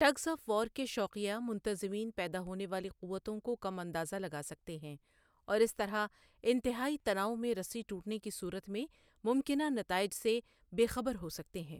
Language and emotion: Urdu, neutral